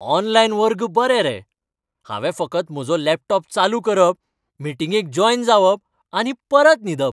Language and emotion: Goan Konkani, happy